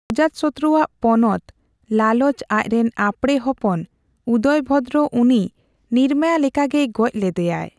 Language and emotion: Santali, neutral